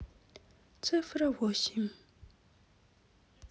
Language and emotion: Russian, sad